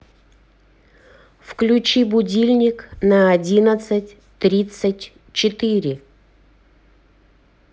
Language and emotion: Russian, neutral